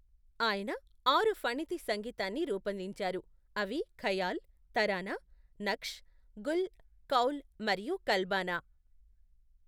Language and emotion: Telugu, neutral